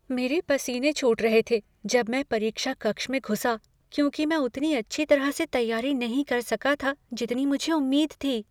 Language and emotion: Hindi, fearful